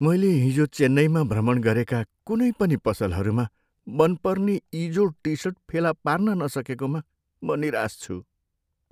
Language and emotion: Nepali, sad